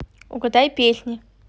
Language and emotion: Russian, neutral